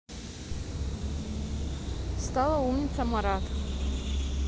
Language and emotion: Russian, neutral